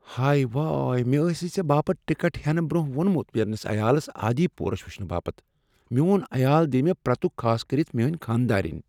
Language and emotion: Kashmiri, fearful